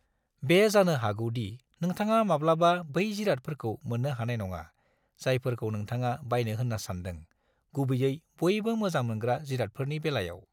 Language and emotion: Bodo, neutral